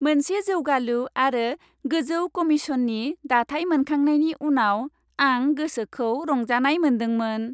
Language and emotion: Bodo, happy